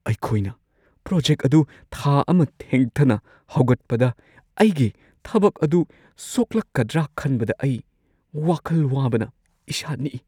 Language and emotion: Manipuri, fearful